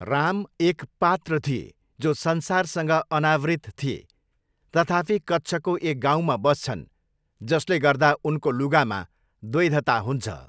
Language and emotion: Nepali, neutral